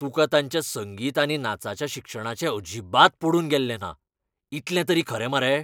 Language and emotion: Goan Konkani, angry